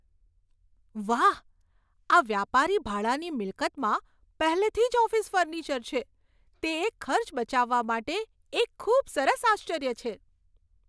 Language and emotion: Gujarati, surprised